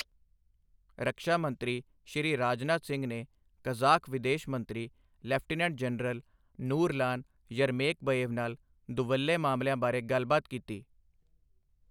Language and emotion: Punjabi, neutral